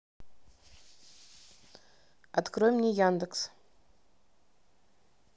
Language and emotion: Russian, neutral